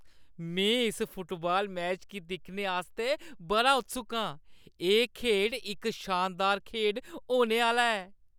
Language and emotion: Dogri, happy